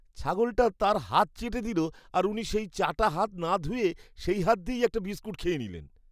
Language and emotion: Bengali, disgusted